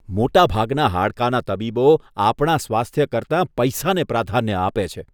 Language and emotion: Gujarati, disgusted